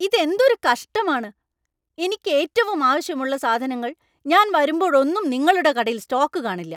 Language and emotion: Malayalam, angry